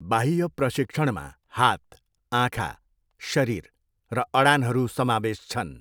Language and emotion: Nepali, neutral